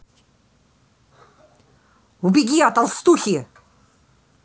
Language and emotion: Russian, angry